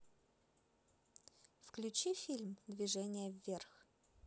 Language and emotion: Russian, positive